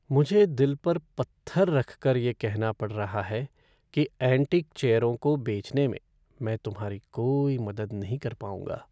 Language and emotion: Hindi, sad